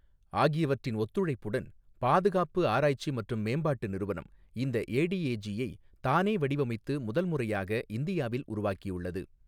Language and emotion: Tamil, neutral